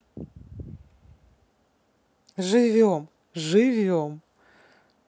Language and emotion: Russian, neutral